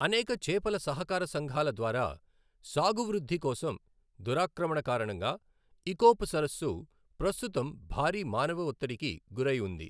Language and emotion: Telugu, neutral